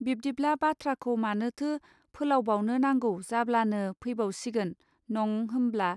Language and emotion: Bodo, neutral